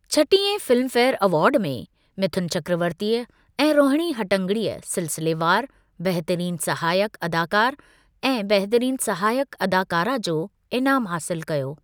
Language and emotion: Sindhi, neutral